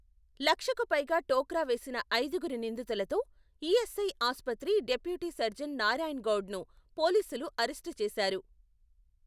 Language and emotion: Telugu, neutral